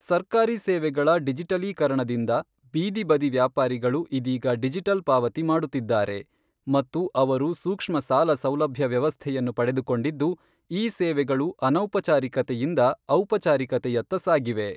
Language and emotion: Kannada, neutral